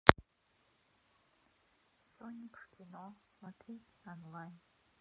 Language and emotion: Russian, neutral